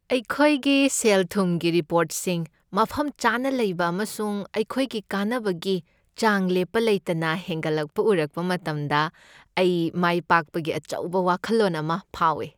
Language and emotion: Manipuri, happy